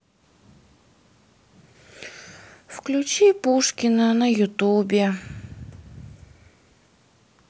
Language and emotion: Russian, sad